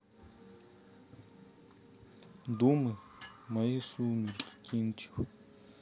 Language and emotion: Russian, sad